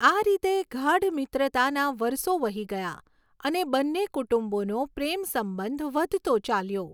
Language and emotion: Gujarati, neutral